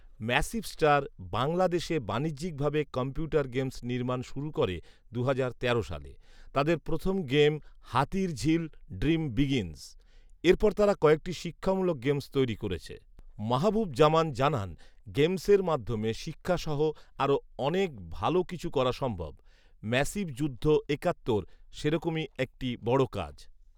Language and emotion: Bengali, neutral